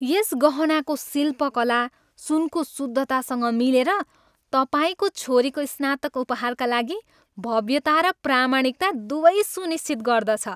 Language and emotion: Nepali, happy